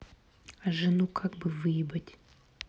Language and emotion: Russian, neutral